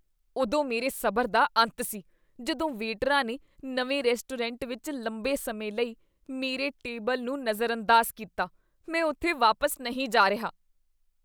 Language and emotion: Punjabi, disgusted